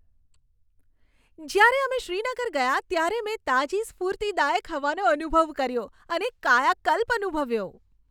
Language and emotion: Gujarati, happy